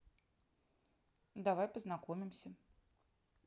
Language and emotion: Russian, neutral